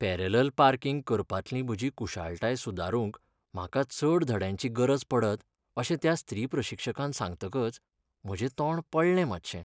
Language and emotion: Goan Konkani, sad